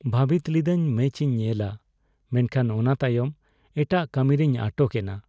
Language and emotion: Santali, sad